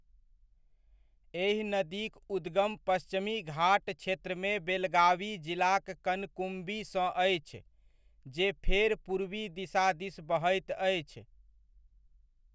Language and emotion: Maithili, neutral